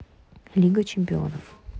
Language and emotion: Russian, neutral